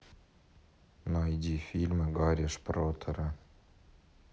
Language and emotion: Russian, neutral